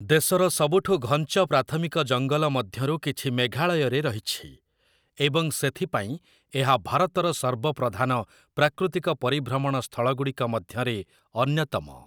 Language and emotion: Odia, neutral